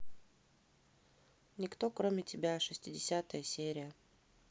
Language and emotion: Russian, neutral